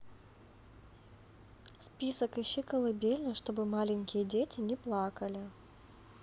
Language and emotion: Russian, neutral